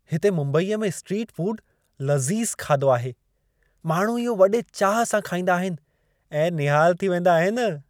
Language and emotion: Sindhi, happy